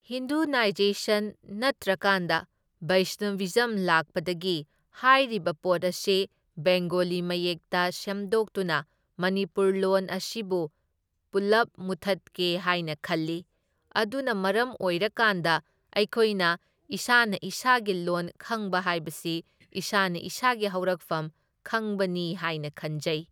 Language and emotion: Manipuri, neutral